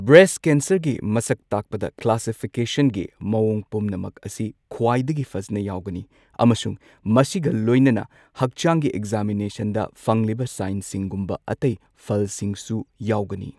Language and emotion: Manipuri, neutral